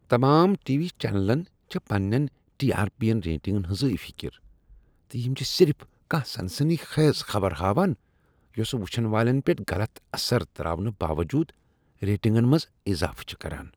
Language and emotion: Kashmiri, disgusted